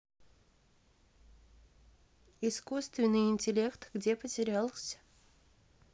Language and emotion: Russian, neutral